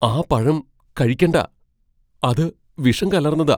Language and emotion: Malayalam, fearful